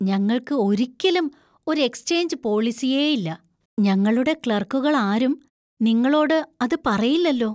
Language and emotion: Malayalam, surprised